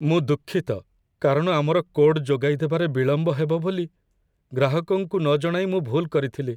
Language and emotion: Odia, sad